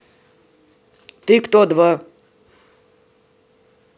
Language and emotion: Russian, neutral